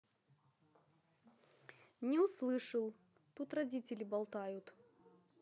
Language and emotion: Russian, neutral